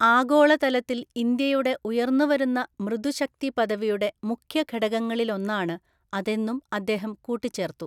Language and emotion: Malayalam, neutral